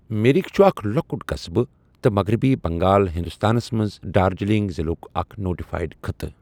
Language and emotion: Kashmiri, neutral